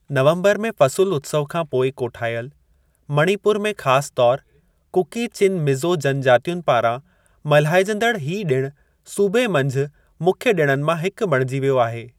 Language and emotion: Sindhi, neutral